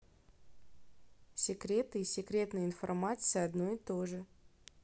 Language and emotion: Russian, neutral